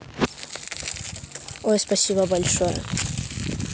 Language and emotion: Russian, positive